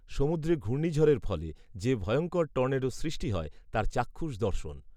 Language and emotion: Bengali, neutral